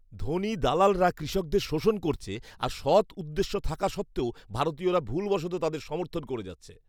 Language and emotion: Bengali, disgusted